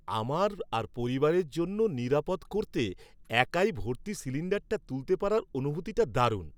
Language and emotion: Bengali, happy